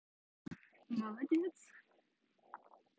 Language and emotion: Russian, positive